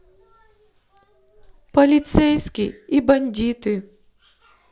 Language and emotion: Russian, sad